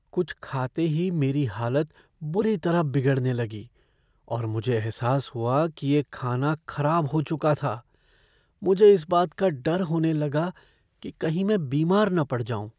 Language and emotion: Hindi, fearful